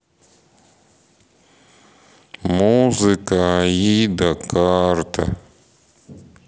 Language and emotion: Russian, sad